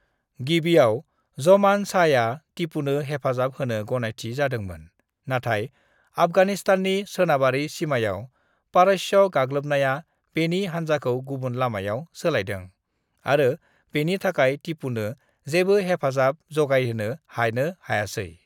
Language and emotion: Bodo, neutral